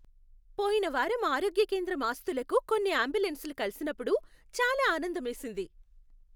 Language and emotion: Telugu, happy